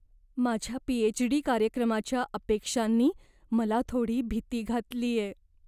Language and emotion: Marathi, fearful